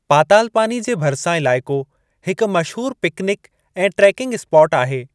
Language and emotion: Sindhi, neutral